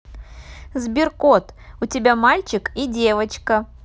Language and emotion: Russian, positive